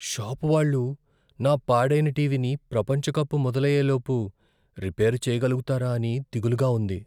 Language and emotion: Telugu, fearful